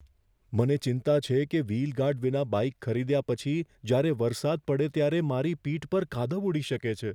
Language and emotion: Gujarati, fearful